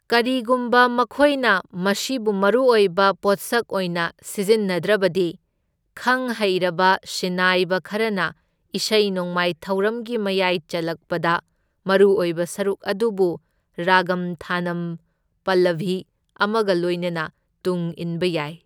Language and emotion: Manipuri, neutral